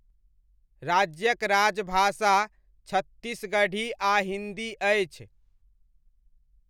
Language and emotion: Maithili, neutral